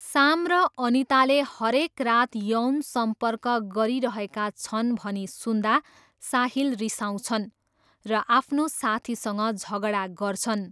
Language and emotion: Nepali, neutral